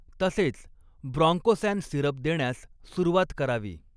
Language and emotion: Marathi, neutral